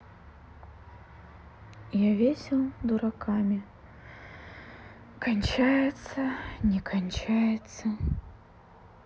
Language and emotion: Russian, sad